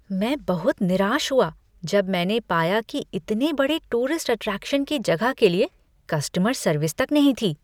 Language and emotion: Hindi, disgusted